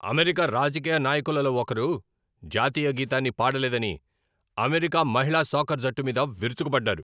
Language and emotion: Telugu, angry